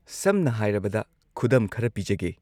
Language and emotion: Manipuri, neutral